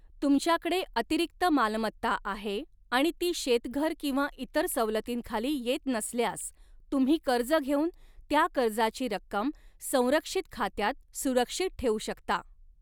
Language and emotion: Marathi, neutral